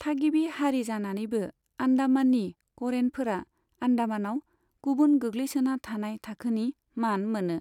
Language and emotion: Bodo, neutral